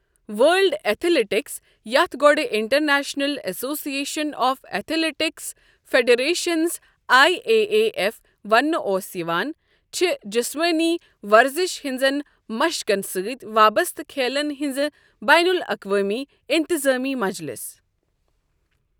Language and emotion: Kashmiri, neutral